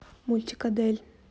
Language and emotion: Russian, neutral